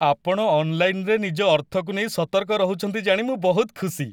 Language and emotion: Odia, happy